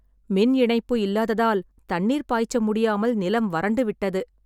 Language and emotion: Tamil, sad